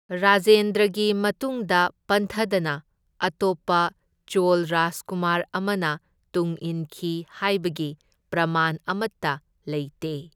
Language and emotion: Manipuri, neutral